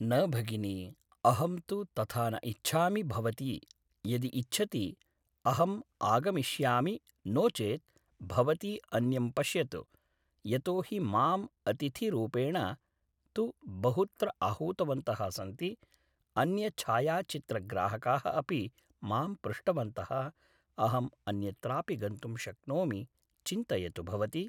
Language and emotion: Sanskrit, neutral